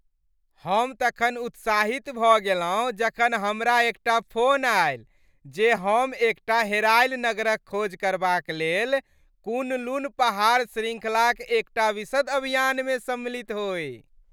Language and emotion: Maithili, happy